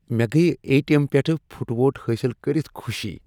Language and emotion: Kashmiri, happy